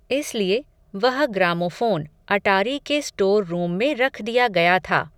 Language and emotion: Hindi, neutral